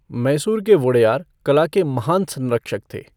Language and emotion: Hindi, neutral